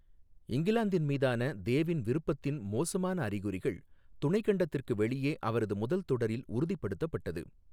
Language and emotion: Tamil, neutral